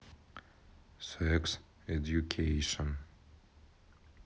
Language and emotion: Russian, neutral